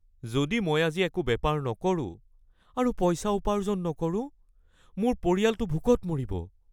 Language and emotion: Assamese, fearful